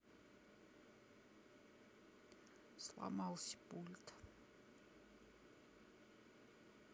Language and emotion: Russian, sad